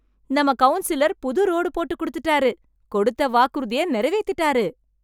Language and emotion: Tamil, happy